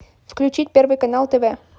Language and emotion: Russian, neutral